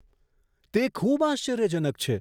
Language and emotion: Gujarati, surprised